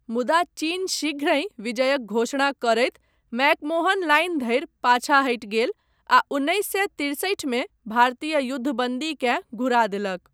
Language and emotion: Maithili, neutral